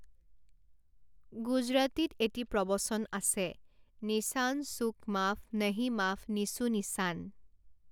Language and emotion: Assamese, neutral